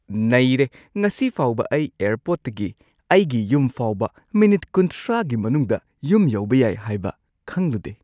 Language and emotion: Manipuri, surprised